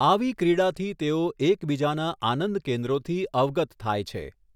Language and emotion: Gujarati, neutral